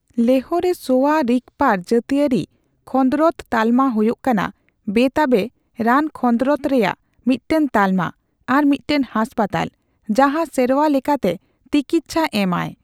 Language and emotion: Santali, neutral